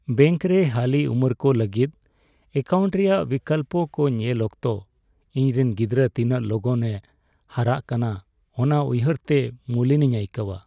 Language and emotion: Santali, sad